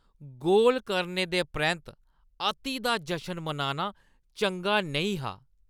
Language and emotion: Dogri, disgusted